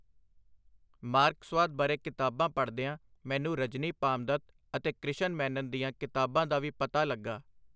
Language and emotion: Punjabi, neutral